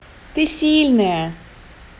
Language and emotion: Russian, positive